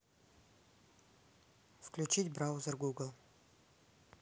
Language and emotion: Russian, neutral